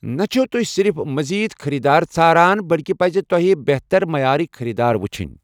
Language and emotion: Kashmiri, neutral